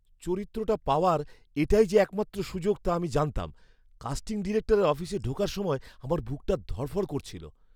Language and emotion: Bengali, fearful